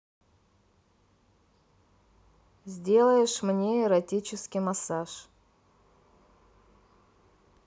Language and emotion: Russian, neutral